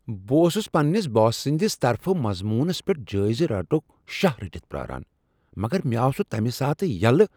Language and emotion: Kashmiri, surprised